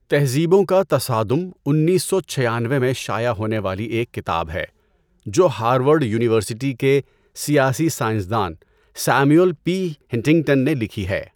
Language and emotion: Urdu, neutral